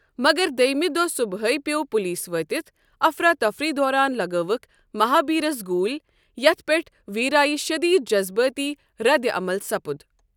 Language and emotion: Kashmiri, neutral